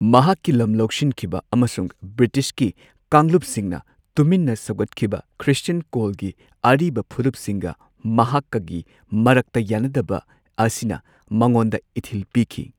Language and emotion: Manipuri, neutral